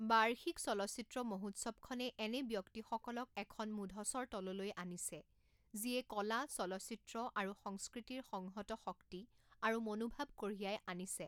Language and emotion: Assamese, neutral